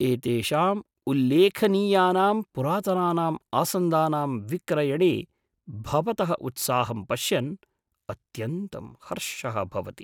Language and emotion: Sanskrit, surprised